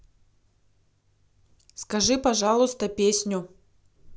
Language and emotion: Russian, neutral